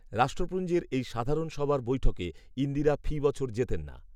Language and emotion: Bengali, neutral